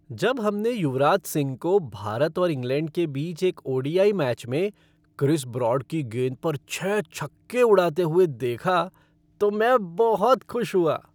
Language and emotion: Hindi, happy